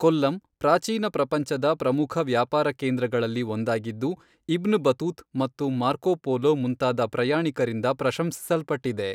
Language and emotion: Kannada, neutral